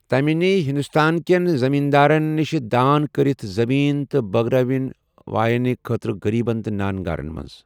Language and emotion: Kashmiri, neutral